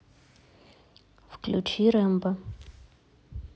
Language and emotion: Russian, neutral